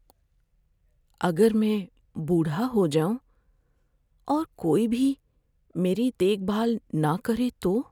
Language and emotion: Urdu, fearful